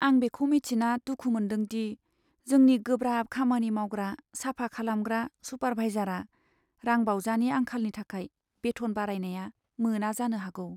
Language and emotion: Bodo, sad